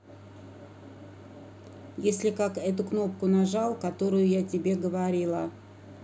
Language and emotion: Russian, neutral